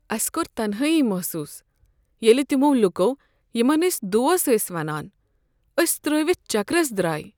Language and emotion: Kashmiri, sad